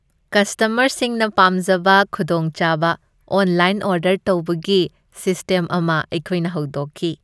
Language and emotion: Manipuri, happy